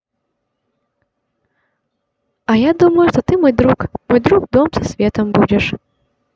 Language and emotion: Russian, positive